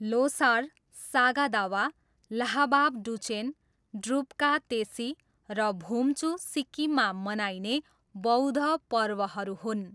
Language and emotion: Nepali, neutral